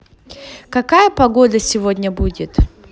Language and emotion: Russian, positive